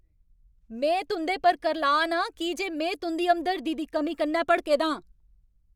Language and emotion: Dogri, angry